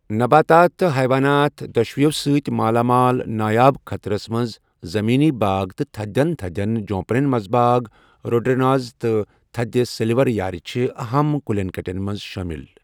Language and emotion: Kashmiri, neutral